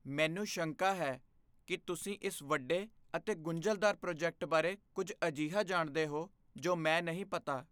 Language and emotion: Punjabi, fearful